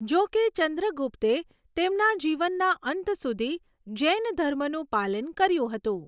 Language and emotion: Gujarati, neutral